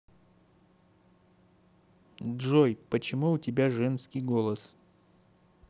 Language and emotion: Russian, neutral